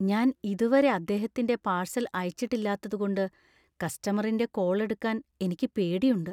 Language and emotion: Malayalam, fearful